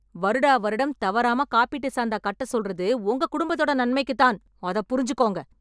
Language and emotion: Tamil, angry